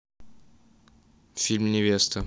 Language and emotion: Russian, neutral